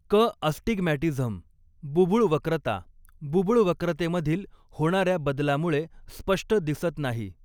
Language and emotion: Marathi, neutral